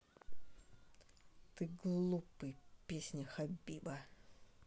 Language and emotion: Russian, angry